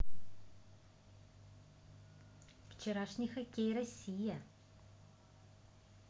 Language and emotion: Russian, positive